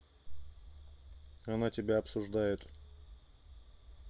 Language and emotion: Russian, neutral